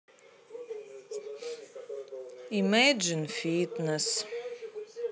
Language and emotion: Russian, sad